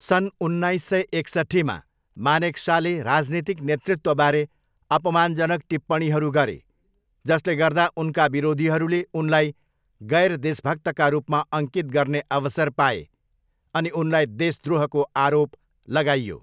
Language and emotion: Nepali, neutral